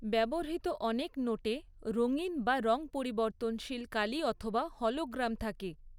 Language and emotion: Bengali, neutral